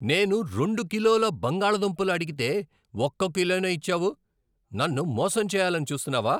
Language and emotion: Telugu, angry